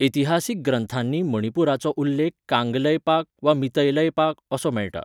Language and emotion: Goan Konkani, neutral